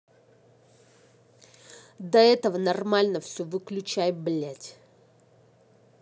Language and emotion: Russian, angry